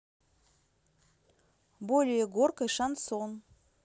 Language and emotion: Russian, neutral